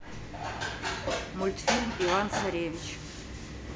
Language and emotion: Russian, neutral